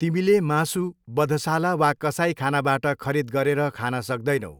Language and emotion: Nepali, neutral